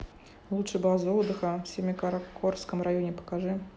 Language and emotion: Russian, neutral